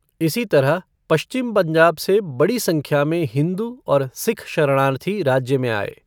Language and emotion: Hindi, neutral